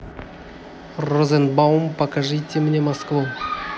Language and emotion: Russian, positive